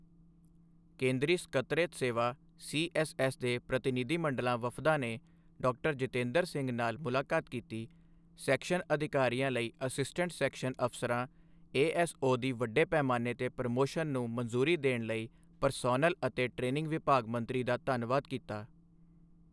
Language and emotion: Punjabi, neutral